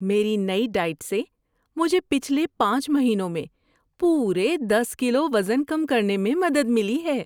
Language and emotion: Urdu, happy